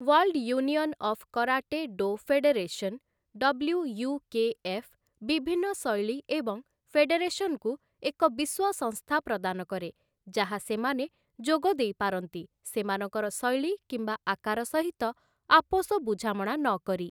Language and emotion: Odia, neutral